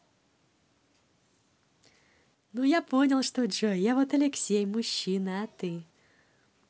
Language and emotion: Russian, positive